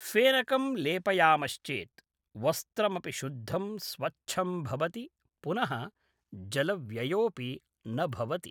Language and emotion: Sanskrit, neutral